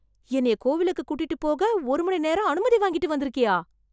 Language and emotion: Tamil, surprised